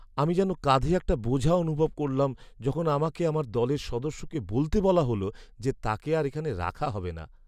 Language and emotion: Bengali, sad